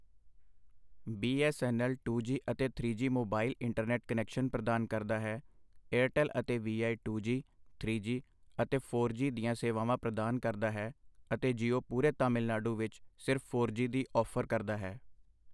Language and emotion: Punjabi, neutral